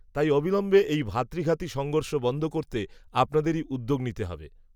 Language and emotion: Bengali, neutral